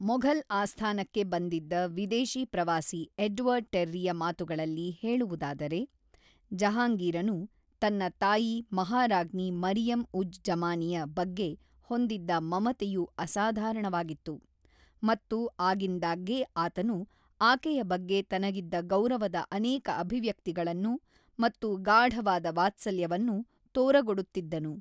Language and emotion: Kannada, neutral